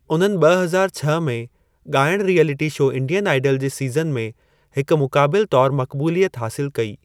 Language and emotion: Sindhi, neutral